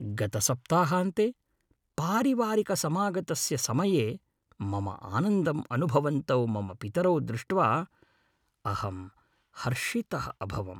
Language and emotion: Sanskrit, happy